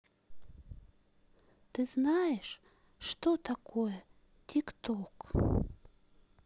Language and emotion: Russian, sad